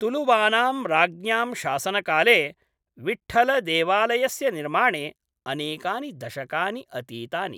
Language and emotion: Sanskrit, neutral